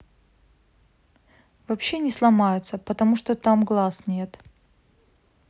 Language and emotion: Russian, neutral